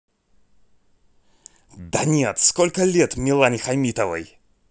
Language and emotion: Russian, angry